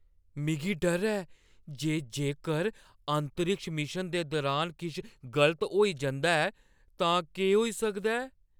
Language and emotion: Dogri, fearful